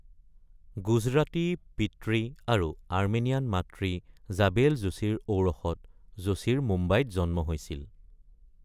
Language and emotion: Assamese, neutral